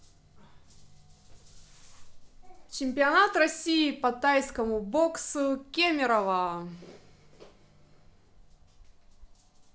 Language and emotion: Russian, positive